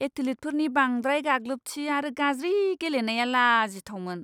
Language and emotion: Bodo, disgusted